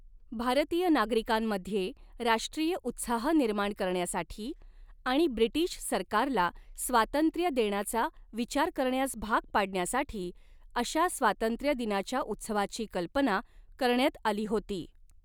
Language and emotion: Marathi, neutral